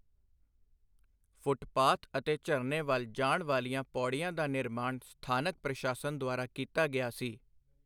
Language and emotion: Punjabi, neutral